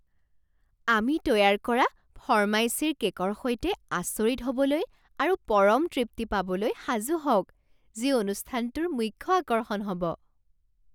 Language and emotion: Assamese, surprised